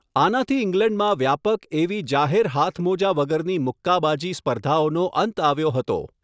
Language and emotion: Gujarati, neutral